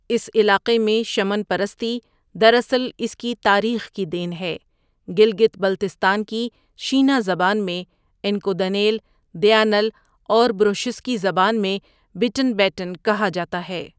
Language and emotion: Urdu, neutral